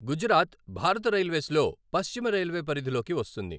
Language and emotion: Telugu, neutral